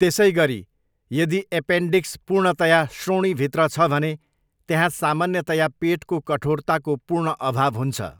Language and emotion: Nepali, neutral